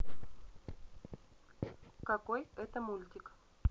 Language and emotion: Russian, neutral